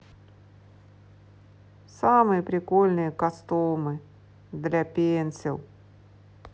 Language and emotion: Russian, sad